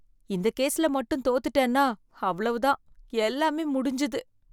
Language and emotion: Tamil, fearful